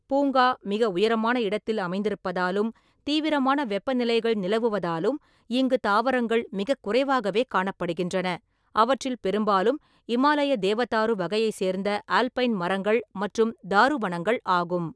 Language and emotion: Tamil, neutral